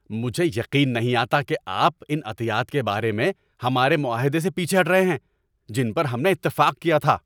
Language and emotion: Urdu, angry